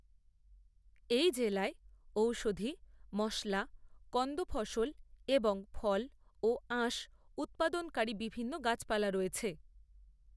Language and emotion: Bengali, neutral